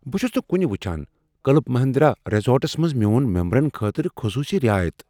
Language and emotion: Kashmiri, surprised